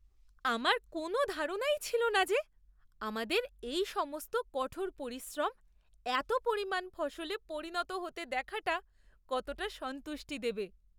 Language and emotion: Bengali, surprised